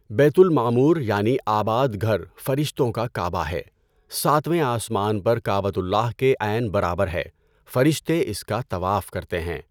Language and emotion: Urdu, neutral